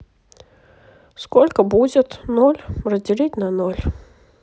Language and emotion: Russian, neutral